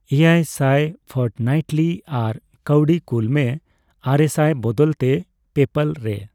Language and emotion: Santali, neutral